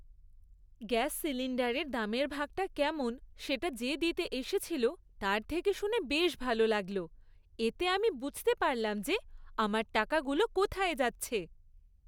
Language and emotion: Bengali, happy